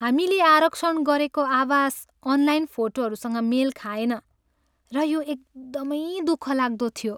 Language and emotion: Nepali, sad